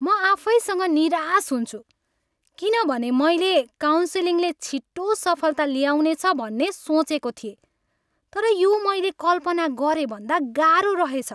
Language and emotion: Nepali, angry